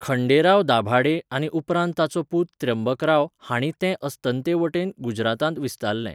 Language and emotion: Goan Konkani, neutral